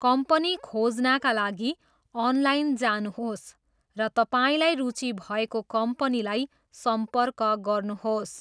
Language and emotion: Nepali, neutral